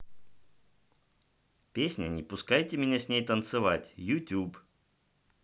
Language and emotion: Russian, neutral